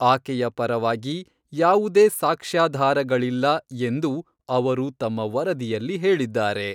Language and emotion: Kannada, neutral